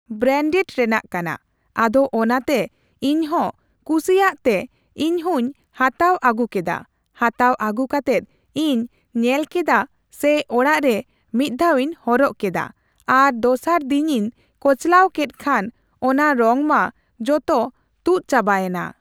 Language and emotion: Santali, neutral